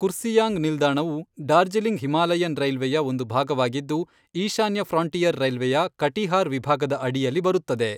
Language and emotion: Kannada, neutral